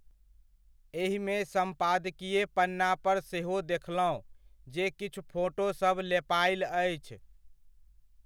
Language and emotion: Maithili, neutral